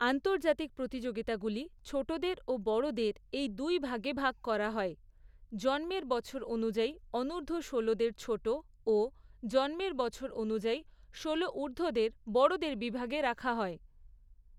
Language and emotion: Bengali, neutral